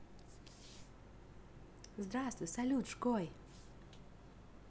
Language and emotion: Russian, positive